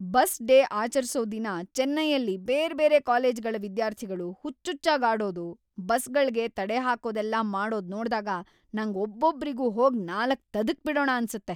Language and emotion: Kannada, angry